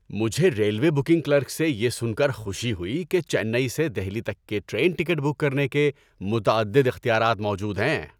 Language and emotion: Urdu, happy